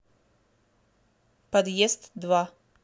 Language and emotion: Russian, neutral